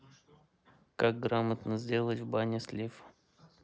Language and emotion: Russian, neutral